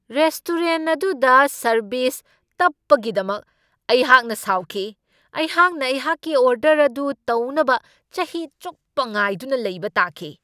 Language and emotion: Manipuri, angry